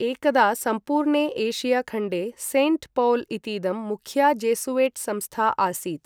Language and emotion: Sanskrit, neutral